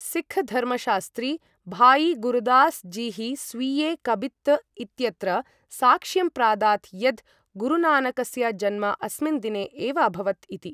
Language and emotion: Sanskrit, neutral